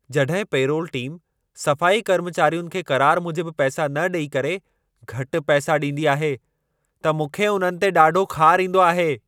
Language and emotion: Sindhi, angry